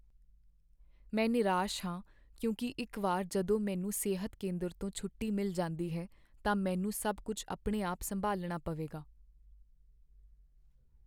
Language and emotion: Punjabi, sad